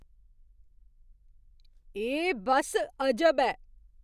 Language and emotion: Dogri, surprised